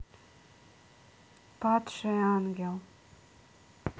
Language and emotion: Russian, neutral